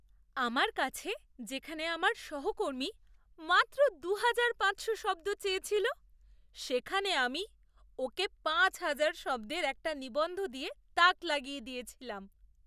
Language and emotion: Bengali, surprised